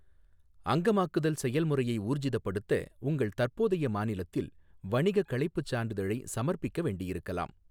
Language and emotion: Tamil, neutral